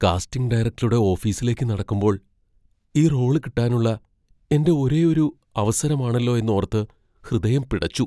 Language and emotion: Malayalam, fearful